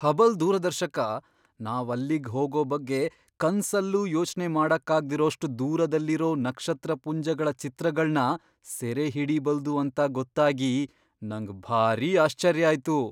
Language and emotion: Kannada, surprised